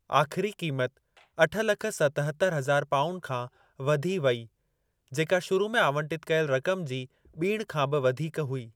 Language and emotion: Sindhi, neutral